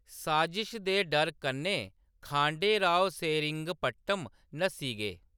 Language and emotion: Dogri, neutral